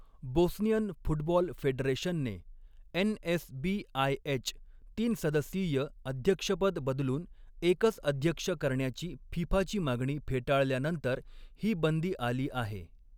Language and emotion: Marathi, neutral